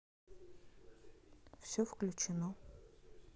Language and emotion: Russian, neutral